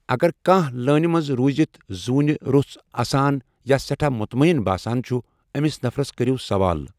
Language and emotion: Kashmiri, neutral